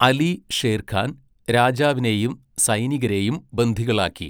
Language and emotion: Malayalam, neutral